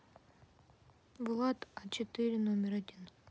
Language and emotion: Russian, neutral